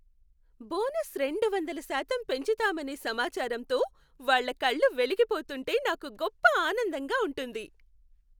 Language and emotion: Telugu, happy